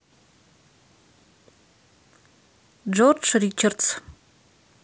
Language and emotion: Russian, neutral